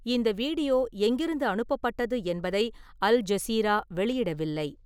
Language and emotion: Tamil, neutral